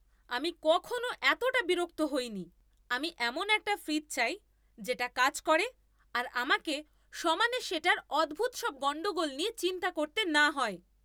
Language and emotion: Bengali, angry